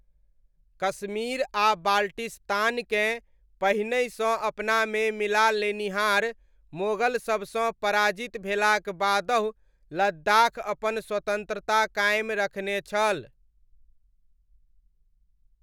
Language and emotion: Maithili, neutral